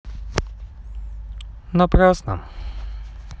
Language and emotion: Russian, sad